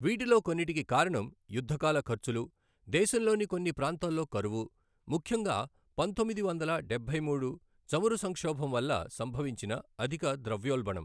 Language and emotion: Telugu, neutral